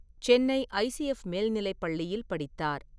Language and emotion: Tamil, neutral